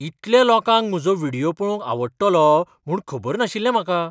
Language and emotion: Goan Konkani, surprised